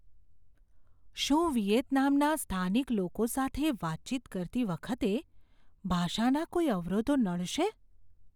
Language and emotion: Gujarati, fearful